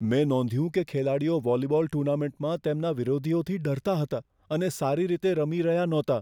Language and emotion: Gujarati, fearful